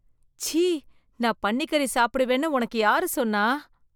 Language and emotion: Tamil, disgusted